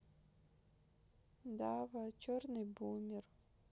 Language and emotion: Russian, sad